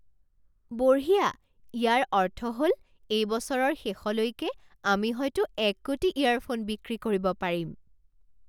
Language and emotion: Assamese, surprised